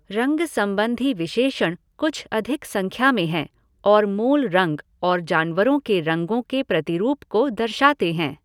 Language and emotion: Hindi, neutral